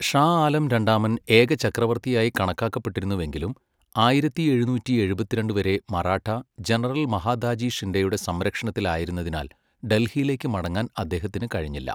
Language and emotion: Malayalam, neutral